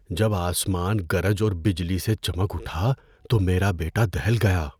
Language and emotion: Urdu, fearful